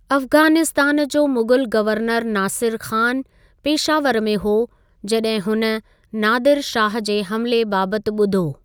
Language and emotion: Sindhi, neutral